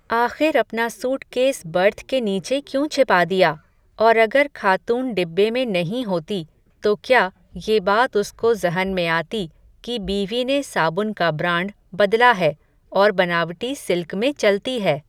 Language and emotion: Hindi, neutral